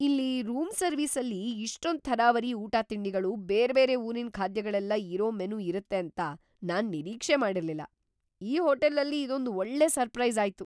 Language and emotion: Kannada, surprised